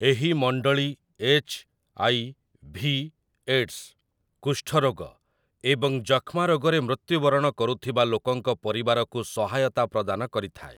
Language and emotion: Odia, neutral